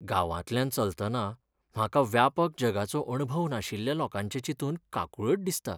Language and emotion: Goan Konkani, sad